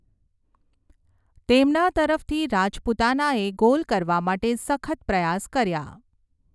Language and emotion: Gujarati, neutral